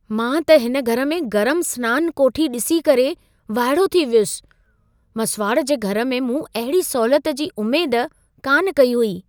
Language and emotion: Sindhi, surprised